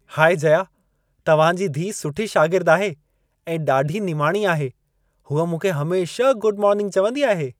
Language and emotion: Sindhi, happy